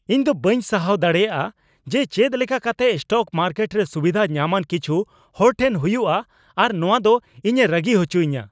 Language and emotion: Santali, angry